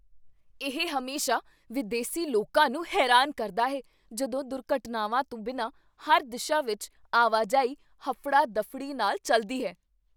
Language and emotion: Punjabi, surprised